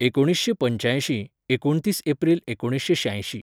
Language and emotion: Goan Konkani, neutral